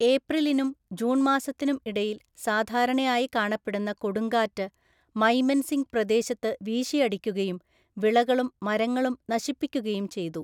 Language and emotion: Malayalam, neutral